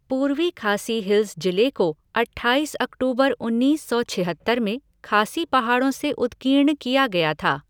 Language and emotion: Hindi, neutral